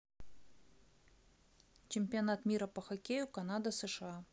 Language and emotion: Russian, neutral